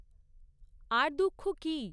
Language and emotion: Bengali, neutral